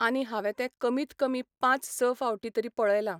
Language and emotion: Goan Konkani, neutral